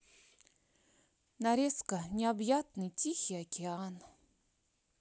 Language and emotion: Russian, sad